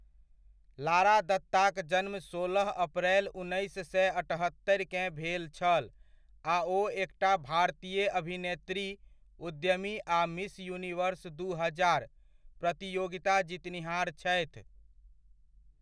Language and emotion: Maithili, neutral